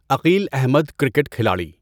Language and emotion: Urdu, neutral